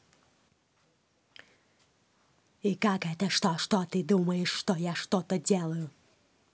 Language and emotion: Russian, angry